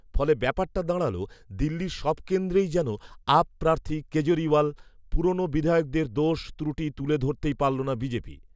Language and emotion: Bengali, neutral